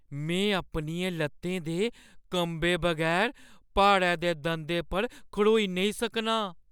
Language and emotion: Dogri, fearful